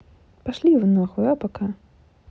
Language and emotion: Russian, angry